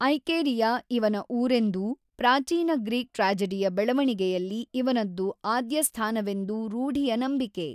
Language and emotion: Kannada, neutral